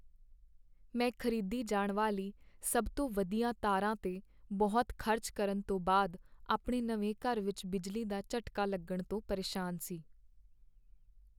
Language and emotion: Punjabi, sad